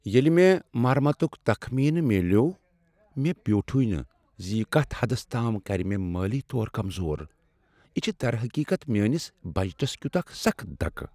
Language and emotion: Kashmiri, sad